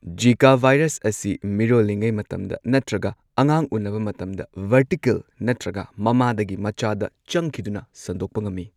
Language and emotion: Manipuri, neutral